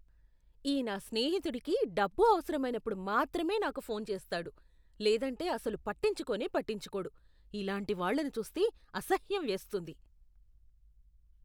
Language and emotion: Telugu, disgusted